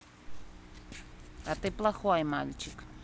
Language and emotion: Russian, neutral